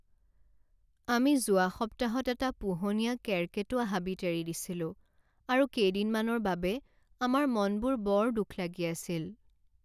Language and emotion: Assamese, sad